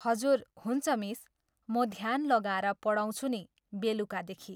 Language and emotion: Nepali, neutral